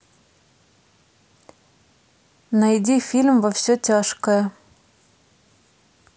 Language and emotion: Russian, neutral